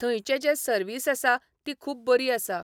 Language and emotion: Goan Konkani, neutral